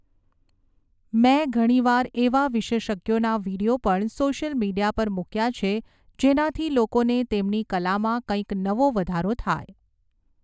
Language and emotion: Gujarati, neutral